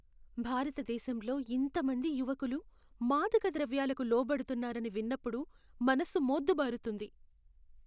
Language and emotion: Telugu, sad